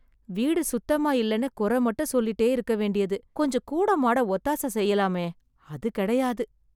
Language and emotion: Tamil, sad